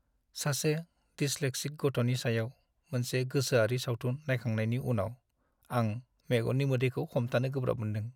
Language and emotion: Bodo, sad